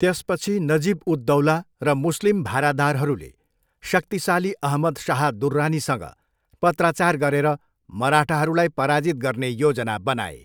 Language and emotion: Nepali, neutral